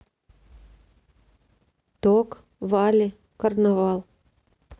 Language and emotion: Russian, neutral